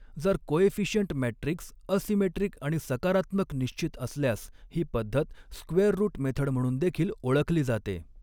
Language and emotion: Marathi, neutral